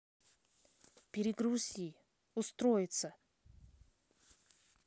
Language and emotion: Russian, neutral